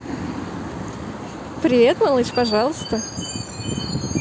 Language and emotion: Russian, positive